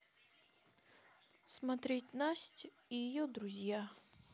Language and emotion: Russian, sad